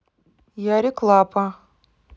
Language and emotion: Russian, neutral